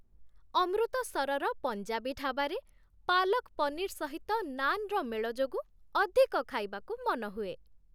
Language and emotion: Odia, happy